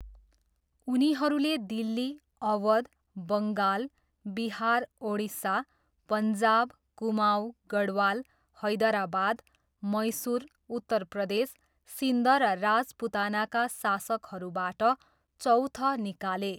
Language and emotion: Nepali, neutral